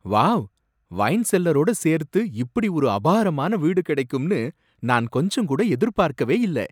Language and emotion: Tamil, surprised